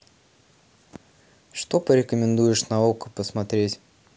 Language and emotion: Russian, neutral